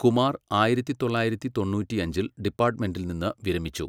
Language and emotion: Malayalam, neutral